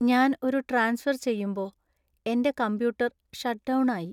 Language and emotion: Malayalam, sad